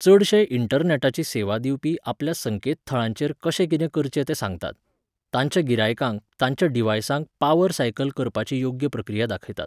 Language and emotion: Goan Konkani, neutral